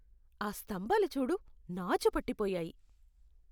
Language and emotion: Telugu, disgusted